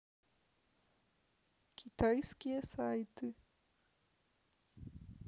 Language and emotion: Russian, neutral